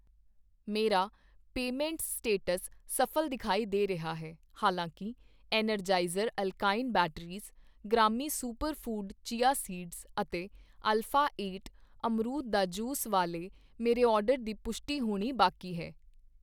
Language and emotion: Punjabi, neutral